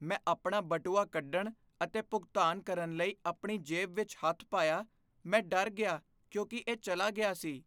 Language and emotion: Punjabi, fearful